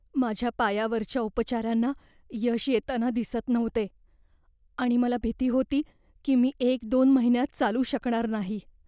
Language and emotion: Marathi, fearful